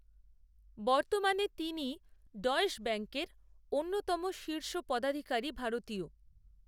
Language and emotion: Bengali, neutral